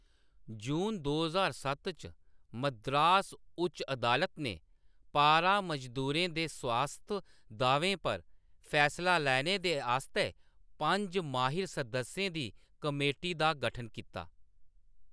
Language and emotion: Dogri, neutral